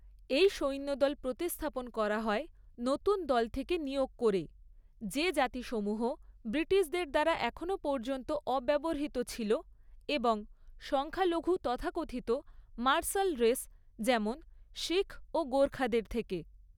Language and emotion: Bengali, neutral